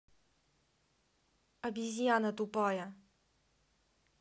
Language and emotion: Russian, angry